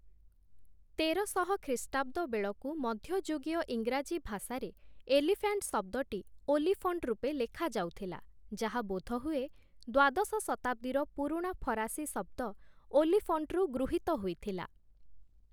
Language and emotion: Odia, neutral